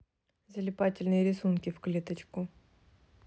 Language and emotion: Russian, neutral